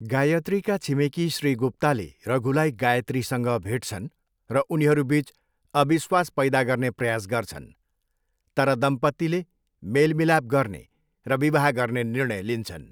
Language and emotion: Nepali, neutral